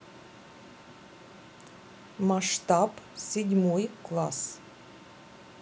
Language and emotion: Russian, neutral